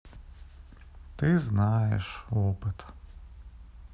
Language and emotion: Russian, sad